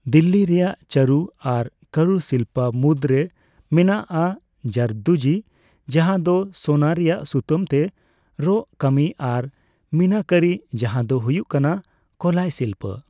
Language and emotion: Santali, neutral